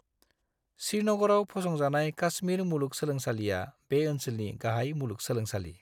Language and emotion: Bodo, neutral